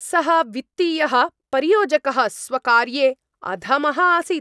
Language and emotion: Sanskrit, angry